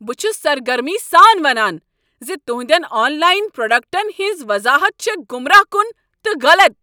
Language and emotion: Kashmiri, angry